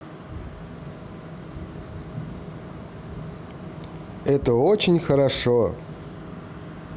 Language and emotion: Russian, positive